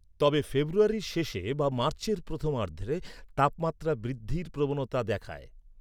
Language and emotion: Bengali, neutral